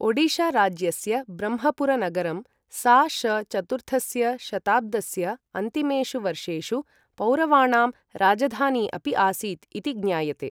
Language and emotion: Sanskrit, neutral